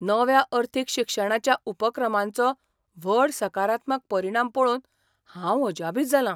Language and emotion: Goan Konkani, surprised